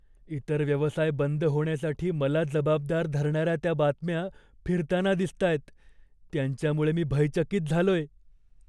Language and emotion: Marathi, fearful